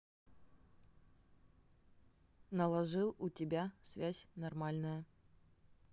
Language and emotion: Russian, neutral